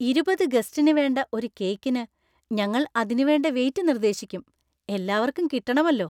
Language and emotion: Malayalam, happy